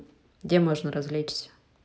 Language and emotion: Russian, neutral